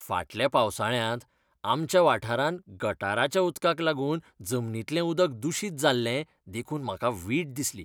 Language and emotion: Goan Konkani, disgusted